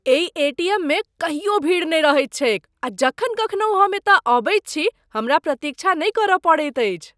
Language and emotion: Maithili, surprised